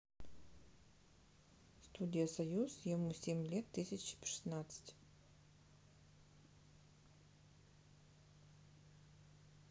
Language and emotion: Russian, neutral